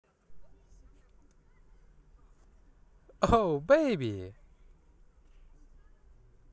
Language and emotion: Russian, positive